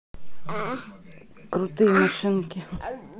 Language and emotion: Russian, neutral